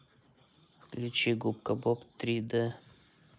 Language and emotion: Russian, neutral